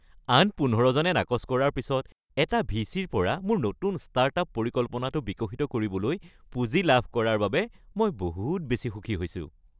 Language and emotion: Assamese, happy